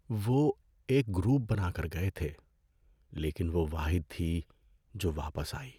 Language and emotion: Urdu, sad